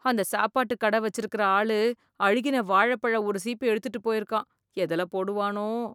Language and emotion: Tamil, disgusted